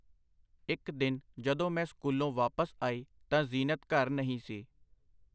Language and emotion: Punjabi, neutral